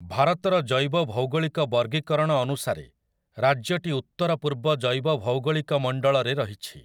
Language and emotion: Odia, neutral